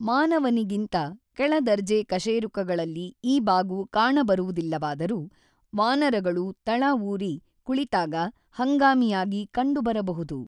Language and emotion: Kannada, neutral